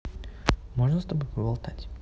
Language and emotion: Russian, neutral